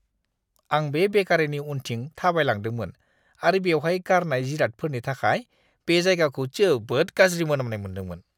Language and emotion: Bodo, disgusted